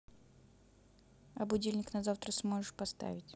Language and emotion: Russian, neutral